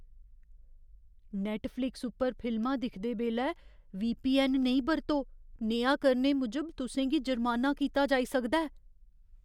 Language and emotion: Dogri, fearful